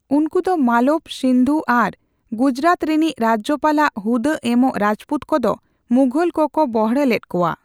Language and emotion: Santali, neutral